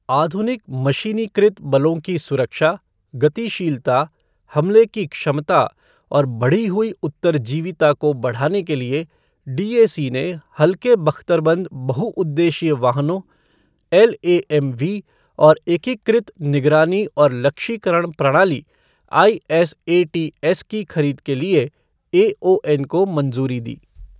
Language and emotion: Hindi, neutral